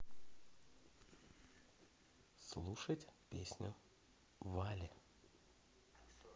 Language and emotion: Russian, positive